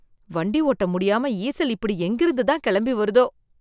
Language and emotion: Tamil, disgusted